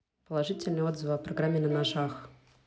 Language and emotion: Russian, neutral